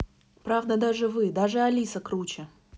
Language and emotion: Russian, neutral